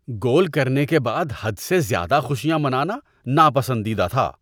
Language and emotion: Urdu, disgusted